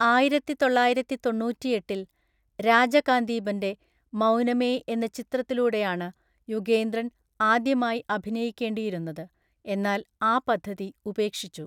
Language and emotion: Malayalam, neutral